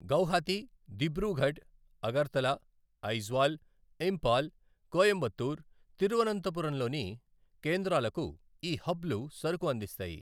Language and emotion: Telugu, neutral